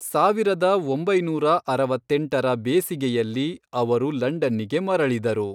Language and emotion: Kannada, neutral